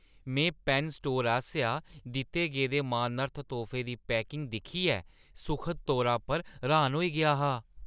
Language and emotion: Dogri, surprised